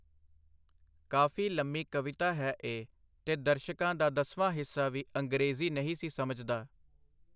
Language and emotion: Punjabi, neutral